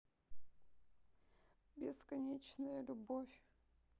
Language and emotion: Russian, sad